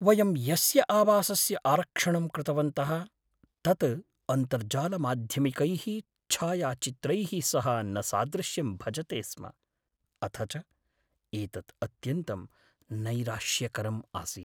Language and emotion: Sanskrit, sad